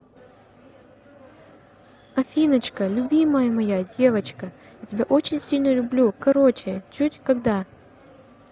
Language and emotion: Russian, positive